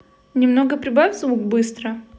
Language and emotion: Russian, neutral